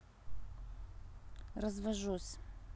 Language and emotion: Russian, neutral